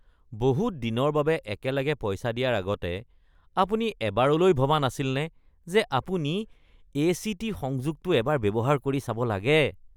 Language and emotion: Assamese, disgusted